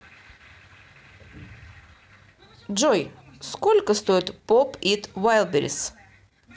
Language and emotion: Russian, neutral